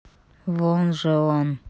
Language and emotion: Russian, angry